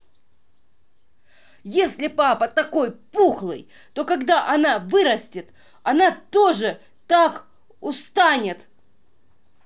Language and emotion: Russian, angry